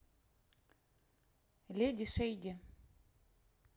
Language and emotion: Russian, neutral